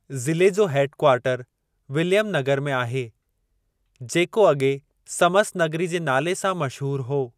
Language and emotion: Sindhi, neutral